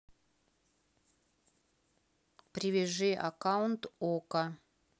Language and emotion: Russian, neutral